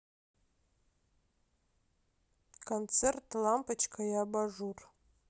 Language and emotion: Russian, neutral